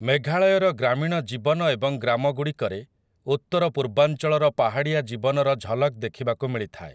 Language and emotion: Odia, neutral